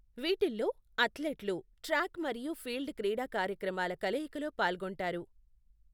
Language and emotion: Telugu, neutral